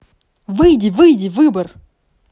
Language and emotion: Russian, neutral